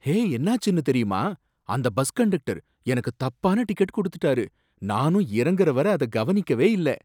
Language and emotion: Tamil, surprised